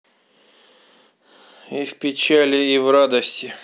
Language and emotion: Russian, sad